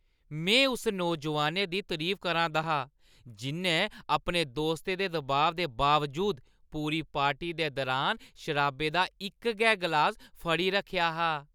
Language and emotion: Dogri, happy